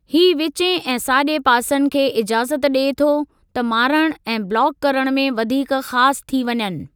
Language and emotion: Sindhi, neutral